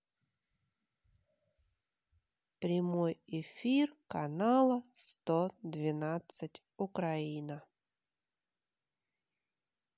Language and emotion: Russian, neutral